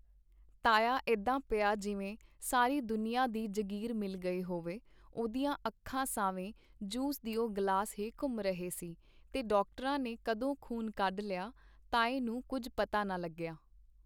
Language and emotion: Punjabi, neutral